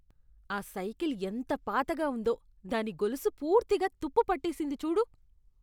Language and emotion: Telugu, disgusted